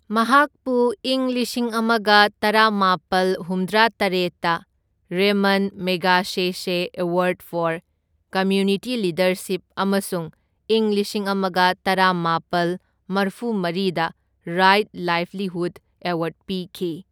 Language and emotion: Manipuri, neutral